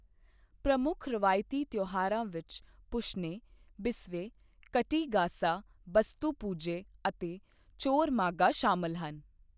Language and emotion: Punjabi, neutral